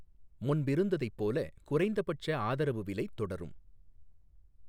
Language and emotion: Tamil, neutral